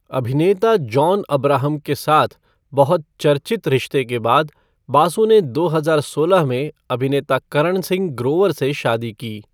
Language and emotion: Hindi, neutral